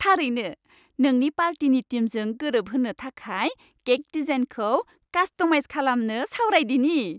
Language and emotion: Bodo, happy